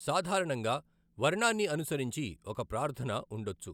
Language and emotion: Telugu, neutral